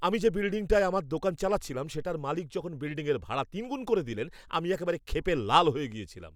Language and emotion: Bengali, angry